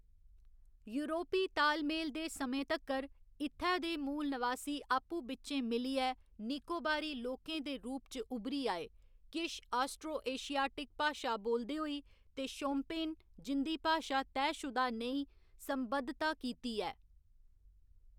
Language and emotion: Dogri, neutral